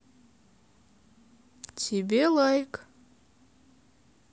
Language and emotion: Russian, neutral